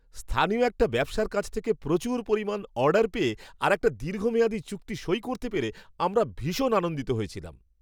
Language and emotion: Bengali, happy